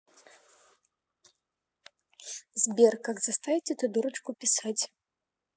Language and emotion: Russian, neutral